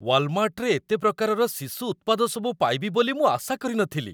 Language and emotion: Odia, surprised